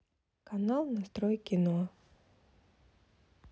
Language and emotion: Russian, neutral